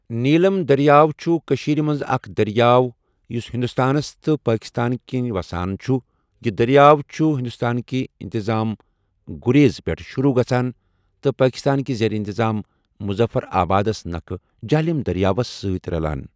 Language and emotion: Kashmiri, neutral